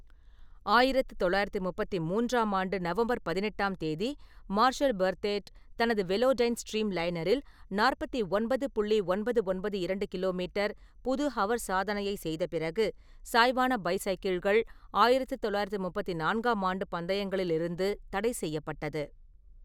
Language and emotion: Tamil, neutral